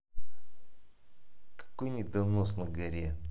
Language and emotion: Russian, angry